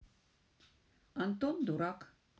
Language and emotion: Russian, positive